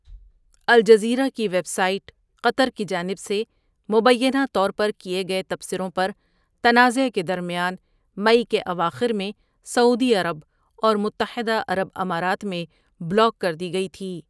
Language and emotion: Urdu, neutral